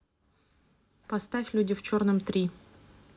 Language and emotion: Russian, neutral